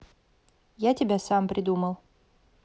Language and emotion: Russian, neutral